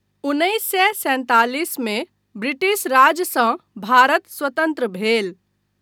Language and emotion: Maithili, neutral